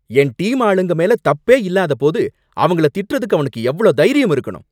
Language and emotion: Tamil, angry